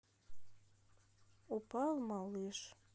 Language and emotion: Russian, sad